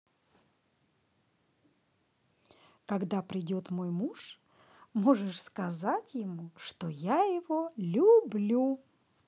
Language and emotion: Russian, positive